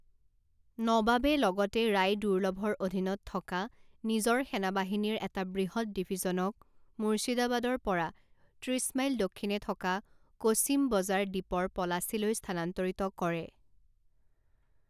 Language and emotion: Assamese, neutral